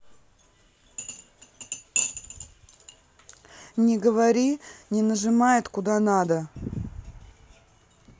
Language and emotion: Russian, neutral